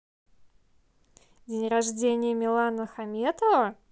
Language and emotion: Russian, positive